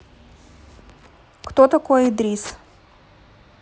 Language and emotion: Russian, neutral